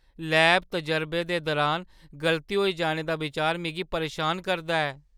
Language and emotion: Dogri, fearful